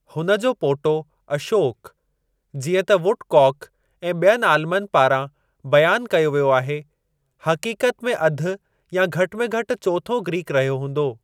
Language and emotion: Sindhi, neutral